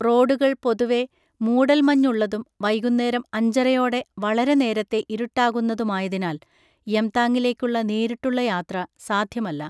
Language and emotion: Malayalam, neutral